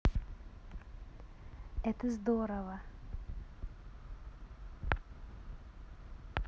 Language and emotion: Russian, positive